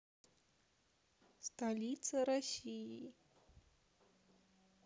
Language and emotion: Russian, neutral